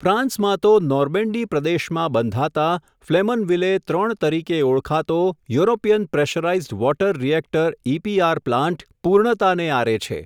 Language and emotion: Gujarati, neutral